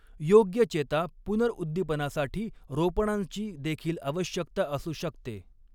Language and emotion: Marathi, neutral